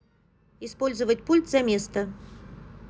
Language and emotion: Russian, neutral